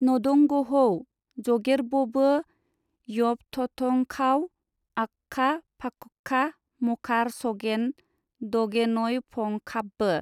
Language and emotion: Bodo, neutral